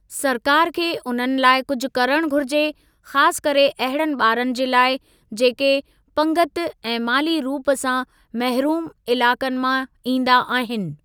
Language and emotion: Sindhi, neutral